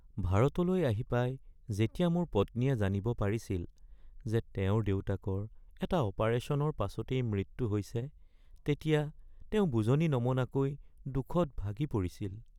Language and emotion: Assamese, sad